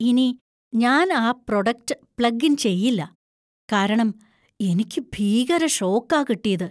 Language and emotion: Malayalam, fearful